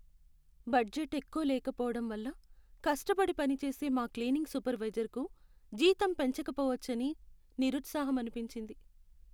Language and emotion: Telugu, sad